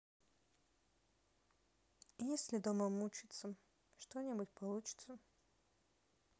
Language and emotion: Russian, sad